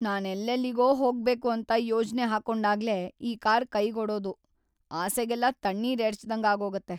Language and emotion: Kannada, sad